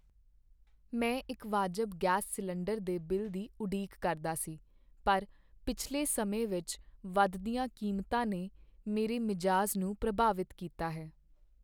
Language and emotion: Punjabi, sad